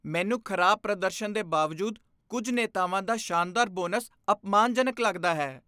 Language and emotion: Punjabi, disgusted